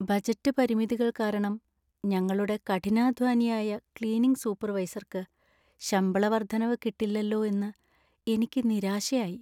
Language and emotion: Malayalam, sad